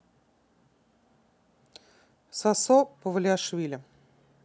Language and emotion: Russian, neutral